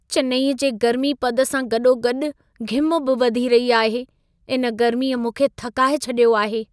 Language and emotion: Sindhi, sad